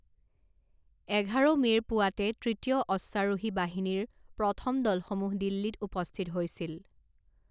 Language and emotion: Assamese, neutral